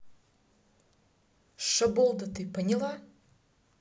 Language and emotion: Russian, angry